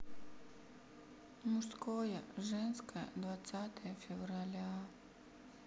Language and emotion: Russian, sad